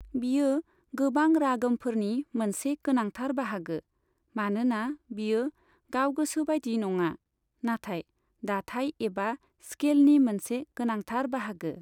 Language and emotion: Bodo, neutral